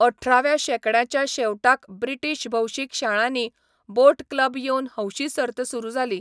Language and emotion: Goan Konkani, neutral